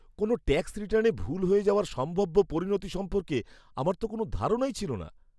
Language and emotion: Bengali, fearful